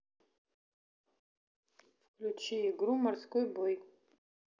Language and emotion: Russian, neutral